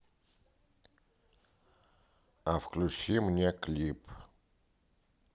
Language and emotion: Russian, neutral